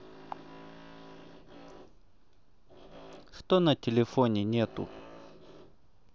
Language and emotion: Russian, neutral